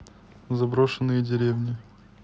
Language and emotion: Russian, neutral